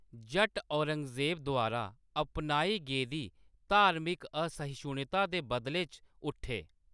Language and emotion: Dogri, neutral